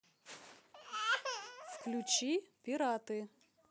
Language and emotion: Russian, neutral